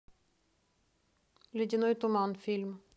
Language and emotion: Russian, neutral